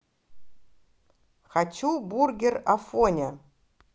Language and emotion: Russian, positive